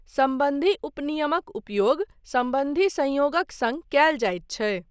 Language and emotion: Maithili, neutral